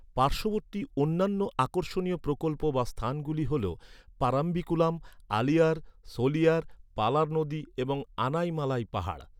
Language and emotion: Bengali, neutral